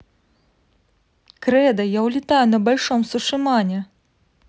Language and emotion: Russian, positive